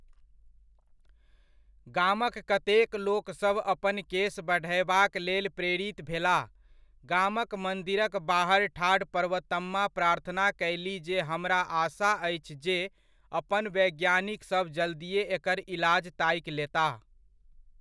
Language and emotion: Maithili, neutral